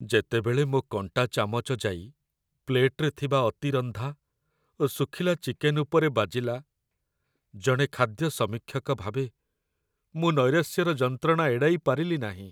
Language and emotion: Odia, sad